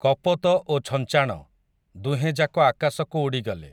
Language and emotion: Odia, neutral